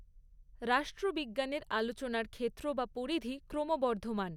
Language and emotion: Bengali, neutral